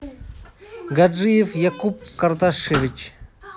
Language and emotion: Russian, neutral